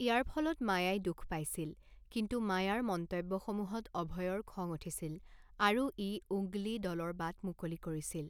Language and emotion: Assamese, neutral